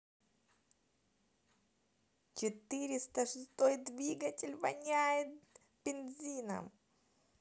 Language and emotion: Russian, positive